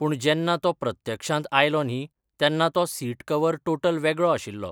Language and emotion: Goan Konkani, neutral